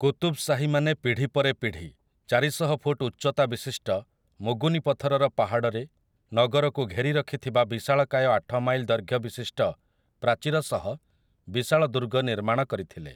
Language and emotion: Odia, neutral